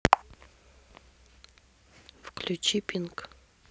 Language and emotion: Russian, neutral